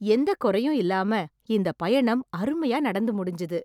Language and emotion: Tamil, happy